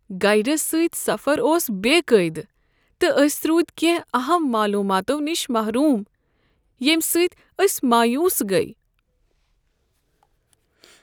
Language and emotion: Kashmiri, sad